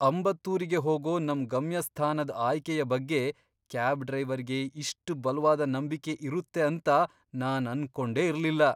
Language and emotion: Kannada, surprised